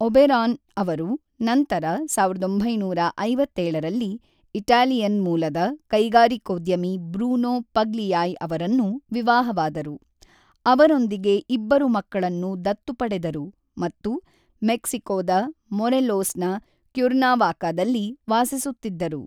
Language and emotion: Kannada, neutral